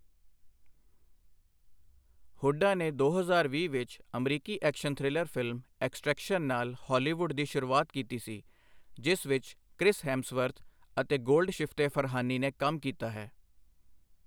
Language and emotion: Punjabi, neutral